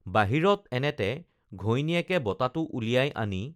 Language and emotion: Assamese, neutral